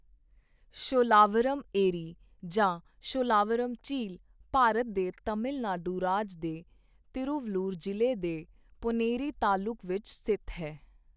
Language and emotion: Punjabi, neutral